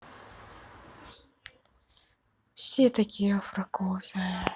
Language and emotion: Russian, sad